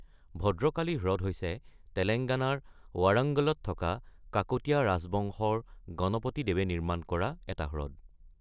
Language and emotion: Assamese, neutral